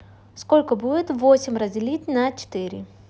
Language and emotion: Russian, neutral